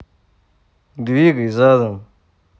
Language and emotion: Russian, neutral